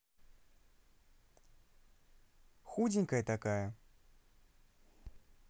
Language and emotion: Russian, neutral